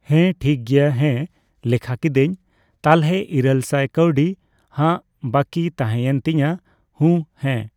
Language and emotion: Santali, neutral